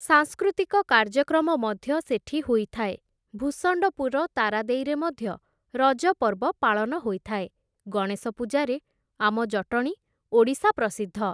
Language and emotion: Odia, neutral